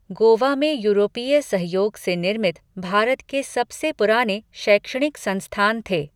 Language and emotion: Hindi, neutral